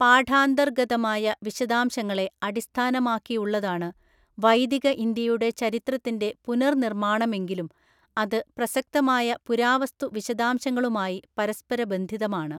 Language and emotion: Malayalam, neutral